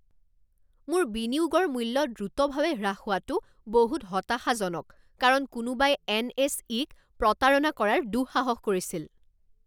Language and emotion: Assamese, angry